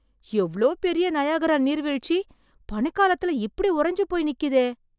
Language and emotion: Tamil, surprised